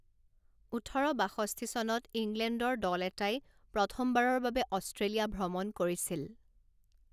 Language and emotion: Assamese, neutral